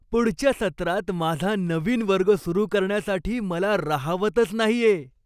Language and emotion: Marathi, happy